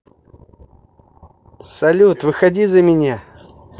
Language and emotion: Russian, positive